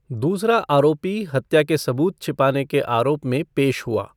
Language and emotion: Hindi, neutral